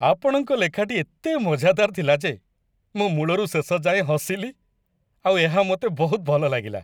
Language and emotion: Odia, happy